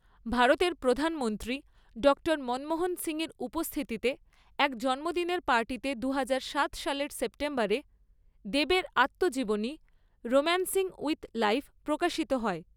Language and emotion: Bengali, neutral